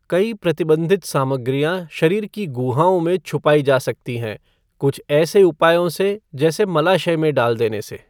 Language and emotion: Hindi, neutral